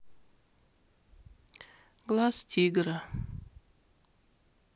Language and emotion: Russian, sad